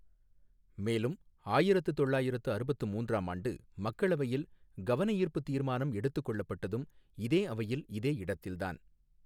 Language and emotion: Tamil, neutral